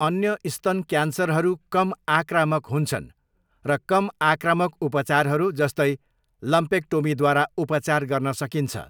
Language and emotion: Nepali, neutral